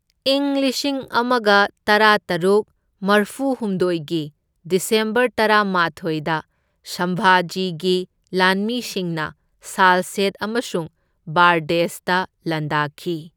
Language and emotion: Manipuri, neutral